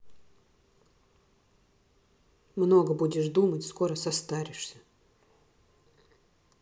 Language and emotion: Russian, sad